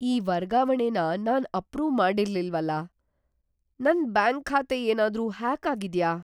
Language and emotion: Kannada, fearful